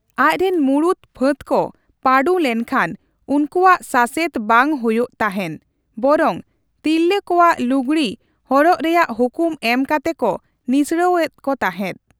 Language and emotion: Santali, neutral